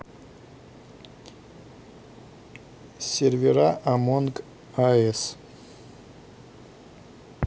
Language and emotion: Russian, neutral